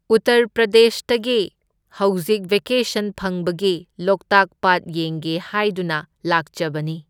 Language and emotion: Manipuri, neutral